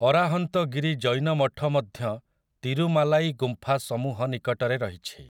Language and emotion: Odia, neutral